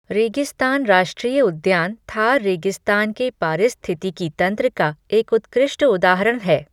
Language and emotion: Hindi, neutral